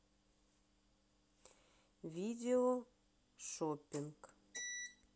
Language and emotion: Russian, neutral